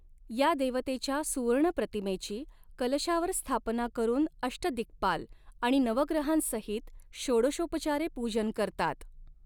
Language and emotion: Marathi, neutral